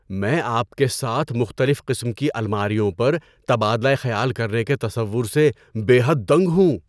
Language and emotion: Urdu, surprised